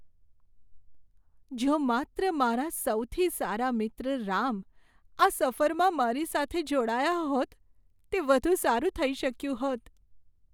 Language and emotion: Gujarati, sad